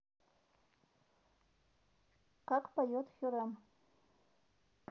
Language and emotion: Russian, neutral